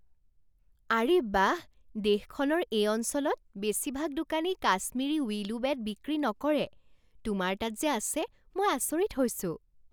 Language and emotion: Assamese, surprised